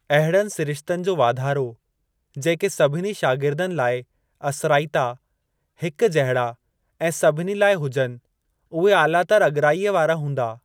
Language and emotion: Sindhi, neutral